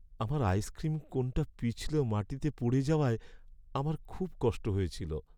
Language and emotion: Bengali, sad